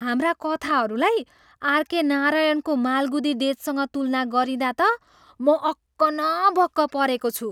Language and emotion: Nepali, surprised